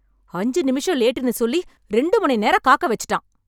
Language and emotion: Tamil, angry